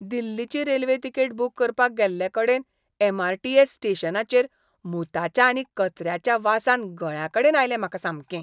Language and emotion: Goan Konkani, disgusted